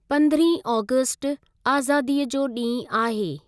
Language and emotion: Sindhi, neutral